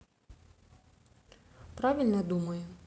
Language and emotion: Russian, neutral